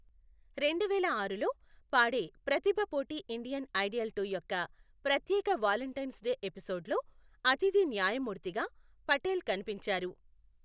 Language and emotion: Telugu, neutral